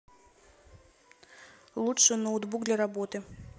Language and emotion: Russian, neutral